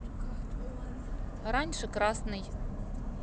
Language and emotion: Russian, neutral